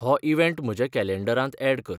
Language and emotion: Goan Konkani, neutral